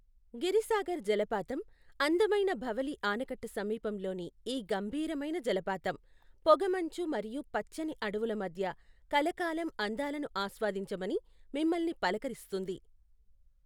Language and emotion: Telugu, neutral